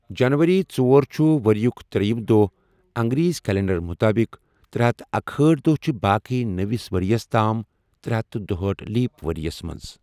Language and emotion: Kashmiri, neutral